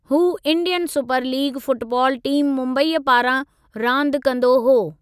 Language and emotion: Sindhi, neutral